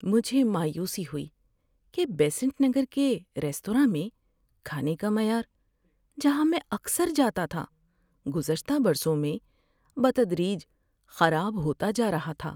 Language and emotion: Urdu, sad